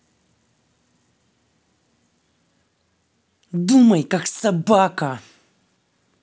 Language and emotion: Russian, angry